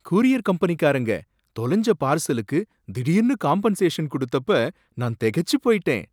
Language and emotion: Tamil, surprised